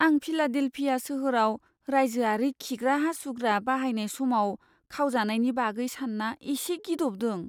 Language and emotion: Bodo, fearful